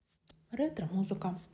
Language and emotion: Russian, neutral